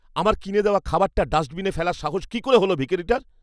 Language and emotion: Bengali, angry